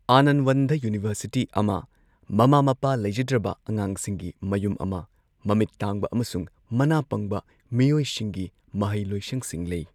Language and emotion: Manipuri, neutral